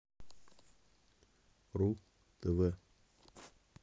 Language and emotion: Russian, neutral